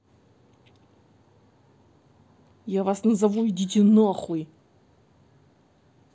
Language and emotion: Russian, angry